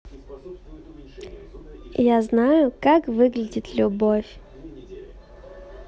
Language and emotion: Russian, positive